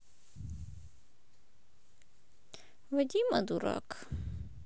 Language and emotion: Russian, sad